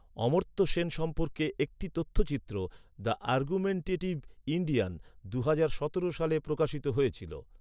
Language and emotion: Bengali, neutral